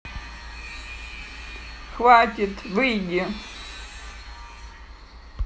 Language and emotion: Russian, angry